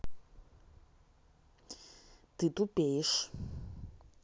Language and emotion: Russian, angry